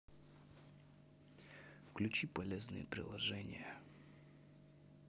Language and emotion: Russian, neutral